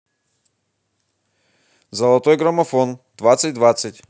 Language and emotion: Russian, positive